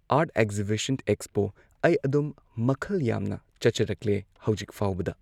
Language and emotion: Manipuri, neutral